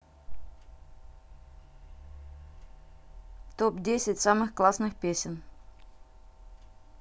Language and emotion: Russian, neutral